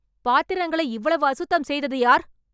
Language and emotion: Tamil, angry